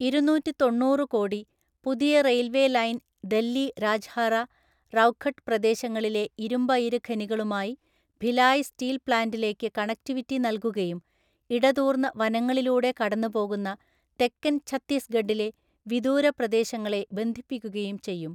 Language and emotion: Malayalam, neutral